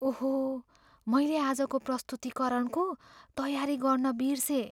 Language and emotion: Nepali, fearful